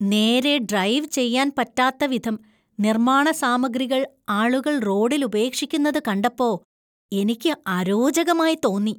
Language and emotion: Malayalam, disgusted